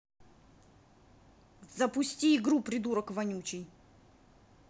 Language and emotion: Russian, angry